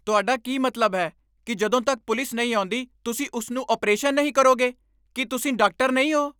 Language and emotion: Punjabi, angry